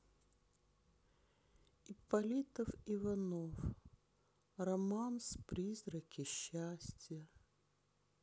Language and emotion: Russian, sad